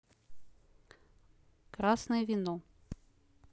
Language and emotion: Russian, neutral